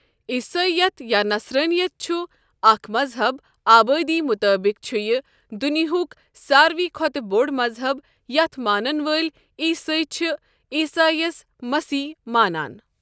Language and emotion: Kashmiri, neutral